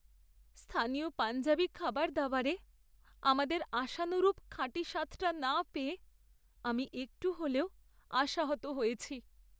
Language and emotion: Bengali, sad